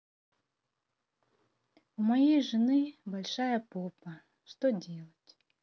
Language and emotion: Russian, sad